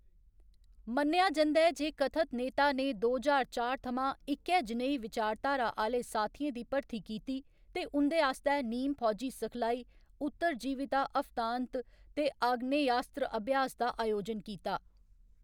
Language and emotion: Dogri, neutral